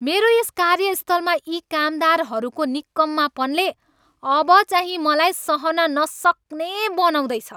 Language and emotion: Nepali, angry